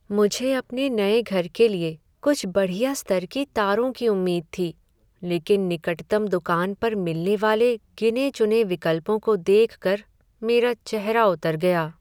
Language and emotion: Hindi, sad